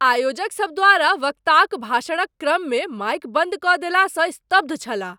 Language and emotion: Maithili, surprised